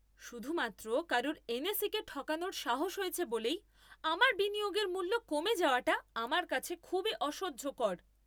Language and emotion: Bengali, angry